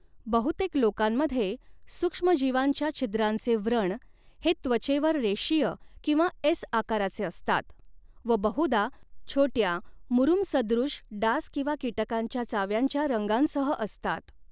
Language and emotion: Marathi, neutral